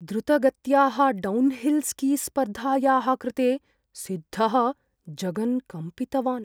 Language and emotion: Sanskrit, fearful